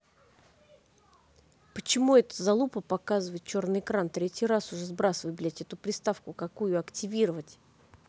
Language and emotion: Russian, angry